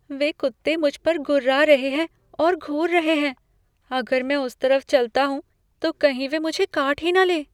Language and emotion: Hindi, fearful